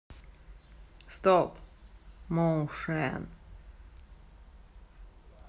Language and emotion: Russian, neutral